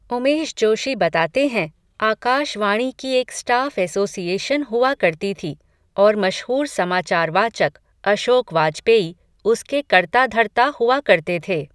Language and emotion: Hindi, neutral